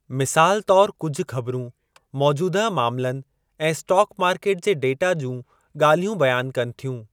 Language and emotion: Sindhi, neutral